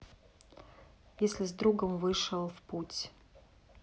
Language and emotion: Russian, neutral